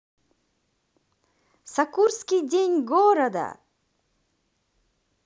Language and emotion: Russian, positive